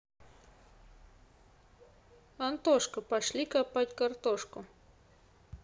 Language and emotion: Russian, neutral